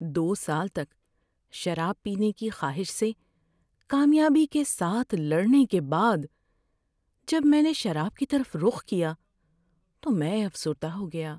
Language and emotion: Urdu, sad